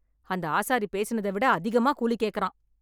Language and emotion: Tamil, angry